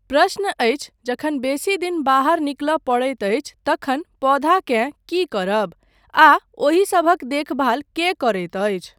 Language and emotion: Maithili, neutral